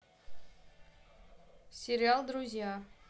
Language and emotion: Russian, neutral